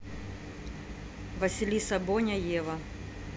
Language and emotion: Russian, neutral